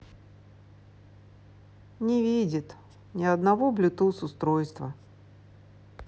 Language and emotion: Russian, sad